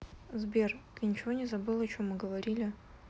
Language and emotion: Russian, neutral